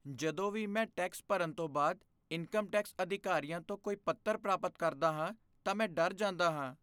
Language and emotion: Punjabi, fearful